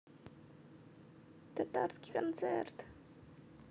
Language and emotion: Russian, neutral